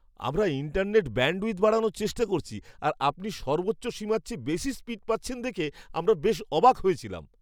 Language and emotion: Bengali, surprised